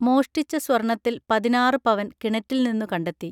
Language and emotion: Malayalam, neutral